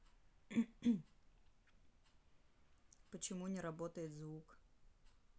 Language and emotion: Russian, neutral